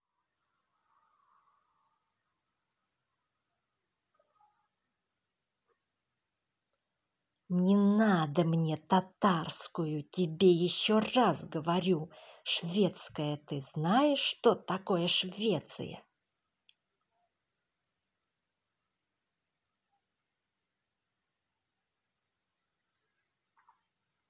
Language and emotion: Russian, angry